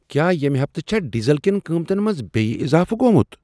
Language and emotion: Kashmiri, surprised